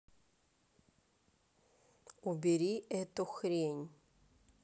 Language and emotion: Russian, angry